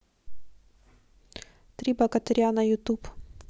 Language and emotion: Russian, neutral